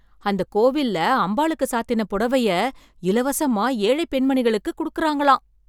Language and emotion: Tamil, surprised